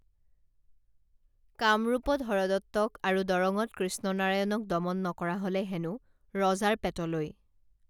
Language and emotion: Assamese, neutral